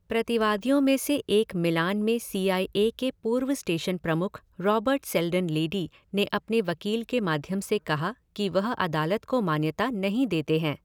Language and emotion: Hindi, neutral